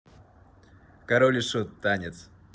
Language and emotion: Russian, neutral